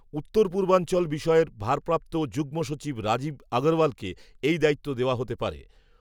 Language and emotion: Bengali, neutral